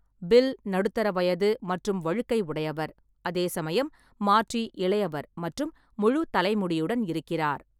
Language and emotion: Tamil, neutral